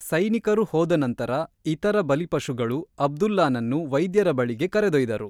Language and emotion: Kannada, neutral